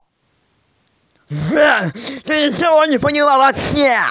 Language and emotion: Russian, angry